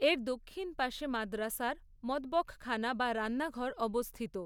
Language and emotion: Bengali, neutral